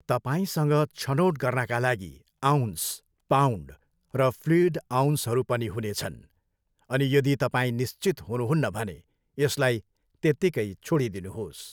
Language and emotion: Nepali, neutral